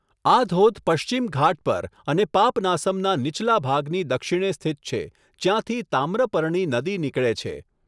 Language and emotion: Gujarati, neutral